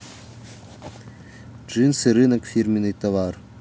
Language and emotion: Russian, neutral